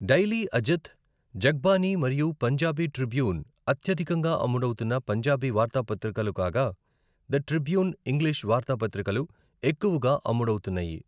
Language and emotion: Telugu, neutral